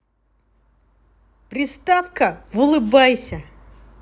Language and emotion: Russian, positive